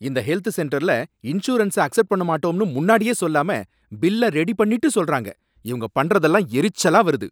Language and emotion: Tamil, angry